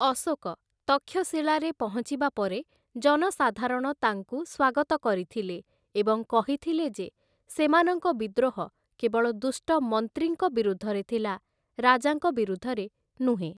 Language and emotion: Odia, neutral